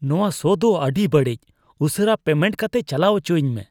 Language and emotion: Santali, disgusted